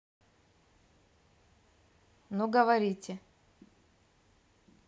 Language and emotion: Russian, neutral